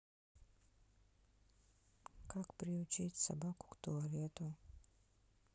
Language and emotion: Russian, sad